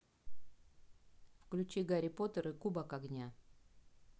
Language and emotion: Russian, neutral